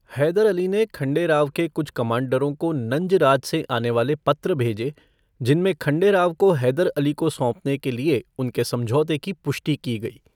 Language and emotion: Hindi, neutral